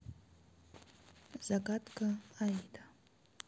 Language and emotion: Russian, neutral